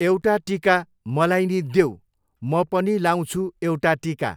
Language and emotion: Nepali, neutral